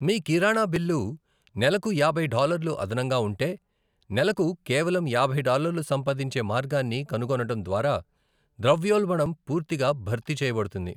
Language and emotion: Telugu, neutral